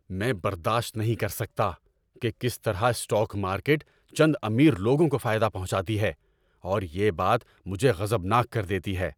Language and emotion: Urdu, angry